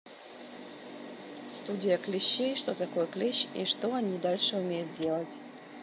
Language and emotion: Russian, neutral